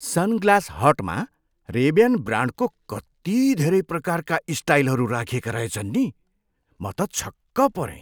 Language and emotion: Nepali, surprised